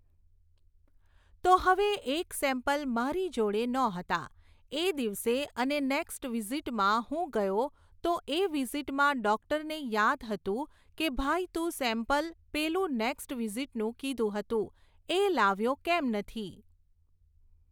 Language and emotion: Gujarati, neutral